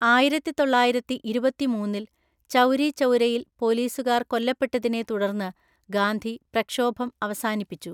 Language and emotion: Malayalam, neutral